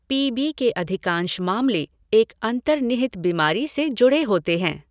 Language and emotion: Hindi, neutral